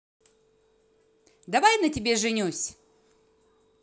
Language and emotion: Russian, positive